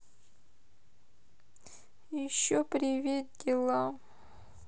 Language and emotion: Russian, sad